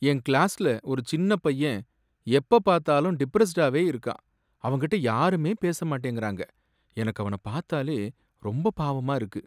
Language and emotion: Tamil, sad